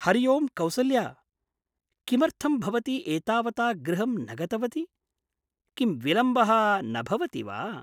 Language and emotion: Sanskrit, surprised